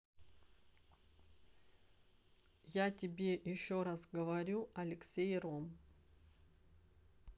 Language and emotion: Russian, neutral